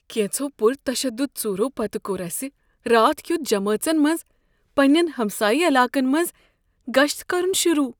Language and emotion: Kashmiri, fearful